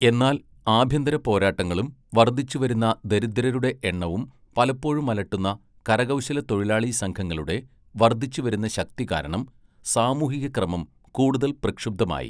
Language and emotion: Malayalam, neutral